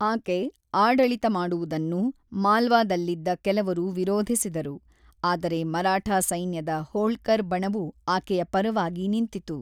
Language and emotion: Kannada, neutral